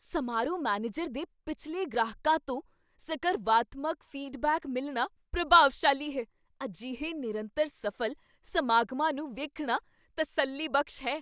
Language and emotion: Punjabi, surprised